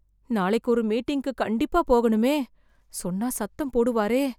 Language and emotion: Tamil, fearful